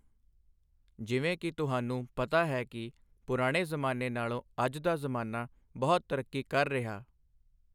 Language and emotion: Punjabi, neutral